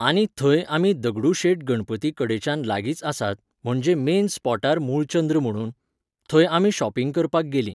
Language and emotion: Goan Konkani, neutral